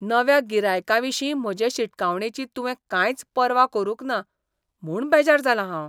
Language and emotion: Goan Konkani, disgusted